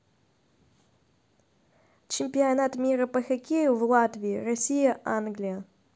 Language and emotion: Russian, neutral